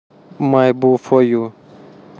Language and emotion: Russian, neutral